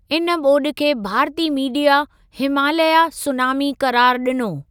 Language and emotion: Sindhi, neutral